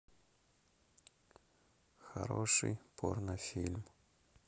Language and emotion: Russian, neutral